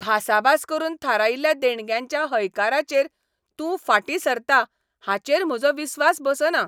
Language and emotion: Goan Konkani, angry